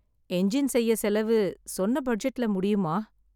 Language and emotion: Tamil, sad